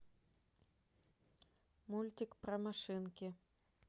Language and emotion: Russian, neutral